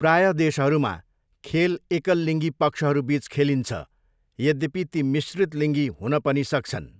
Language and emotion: Nepali, neutral